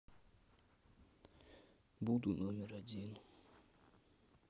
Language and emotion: Russian, sad